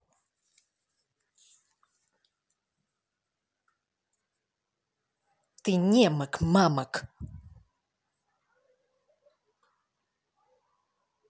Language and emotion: Russian, angry